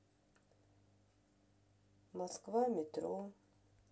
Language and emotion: Russian, sad